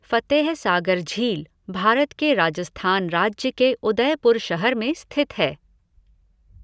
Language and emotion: Hindi, neutral